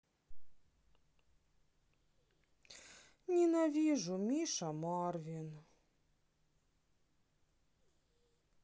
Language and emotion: Russian, sad